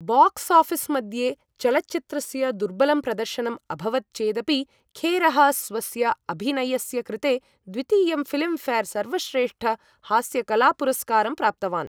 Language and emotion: Sanskrit, neutral